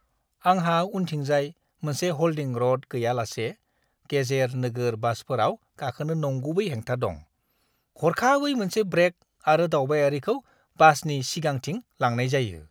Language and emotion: Bodo, disgusted